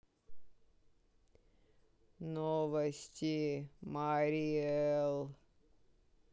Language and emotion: Russian, sad